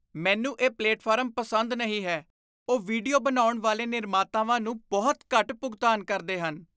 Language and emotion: Punjabi, disgusted